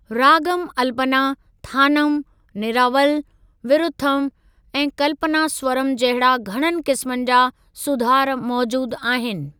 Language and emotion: Sindhi, neutral